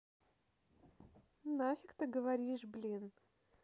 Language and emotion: Russian, angry